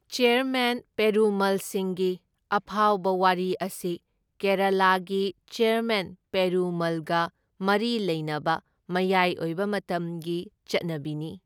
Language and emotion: Manipuri, neutral